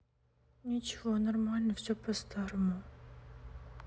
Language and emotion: Russian, sad